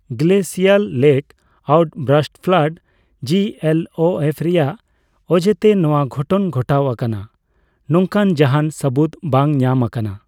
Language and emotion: Santali, neutral